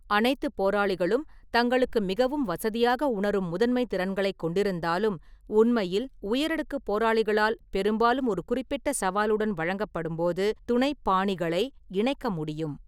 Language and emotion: Tamil, neutral